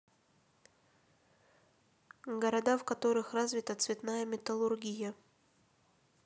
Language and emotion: Russian, neutral